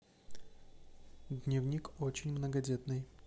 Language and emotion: Russian, neutral